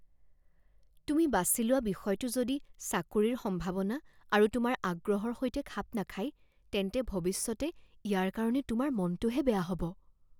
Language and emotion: Assamese, fearful